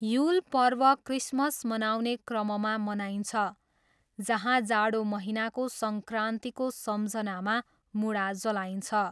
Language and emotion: Nepali, neutral